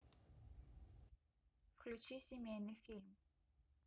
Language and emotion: Russian, neutral